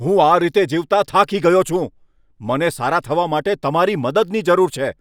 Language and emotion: Gujarati, angry